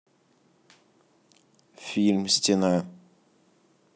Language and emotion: Russian, neutral